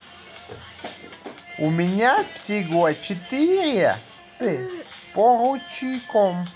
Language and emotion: Russian, positive